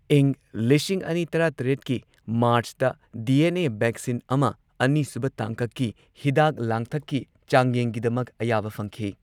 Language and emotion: Manipuri, neutral